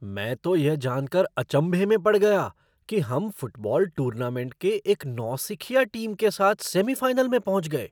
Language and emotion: Hindi, surprised